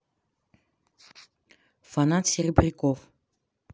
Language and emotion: Russian, neutral